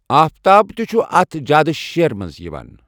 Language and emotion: Kashmiri, neutral